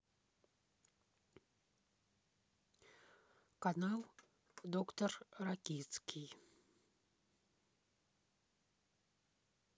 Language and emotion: Russian, neutral